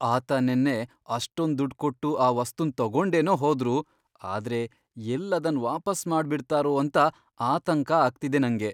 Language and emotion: Kannada, fearful